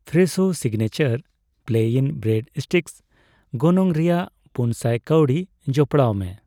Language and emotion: Santali, neutral